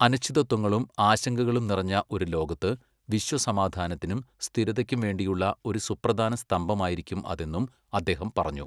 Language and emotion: Malayalam, neutral